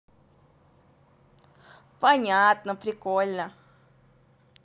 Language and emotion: Russian, positive